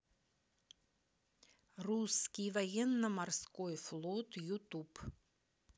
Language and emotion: Russian, neutral